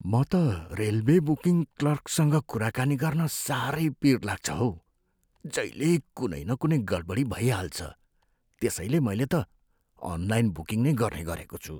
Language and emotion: Nepali, fearful